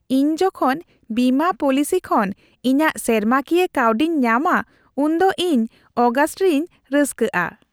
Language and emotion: Santali, happy